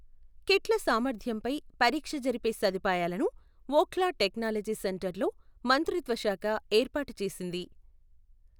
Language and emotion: Telugu, neutral